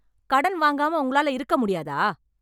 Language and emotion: Tamil, angry